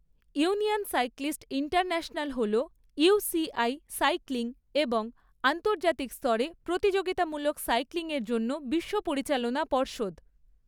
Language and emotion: Bengali, neutral